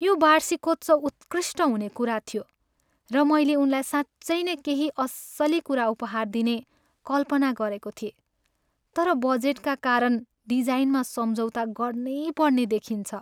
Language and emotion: Nepali, sad